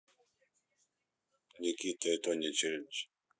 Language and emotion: Russian, neutral